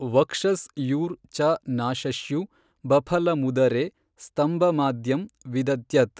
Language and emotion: Kannada, neutral